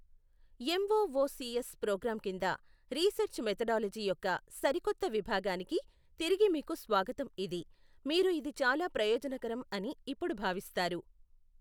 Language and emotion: Telugu, neutral